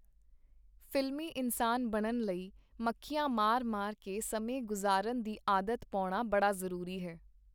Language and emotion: Punjabi, neutral